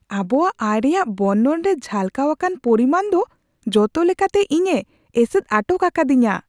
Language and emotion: Santali, surprised